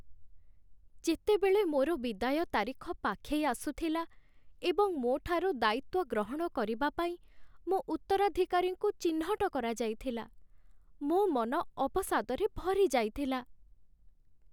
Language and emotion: Odia, sad